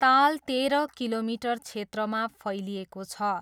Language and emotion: Nepali, neutral